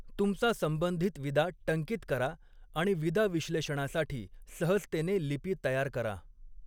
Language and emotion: Marathi, neutral